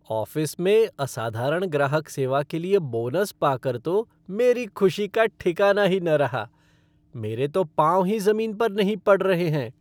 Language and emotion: Hindi, happy